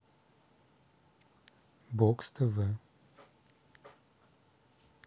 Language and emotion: Russian, neutral